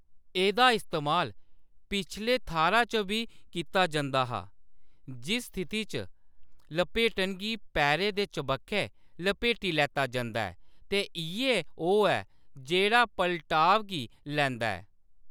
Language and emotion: Dogri, neutral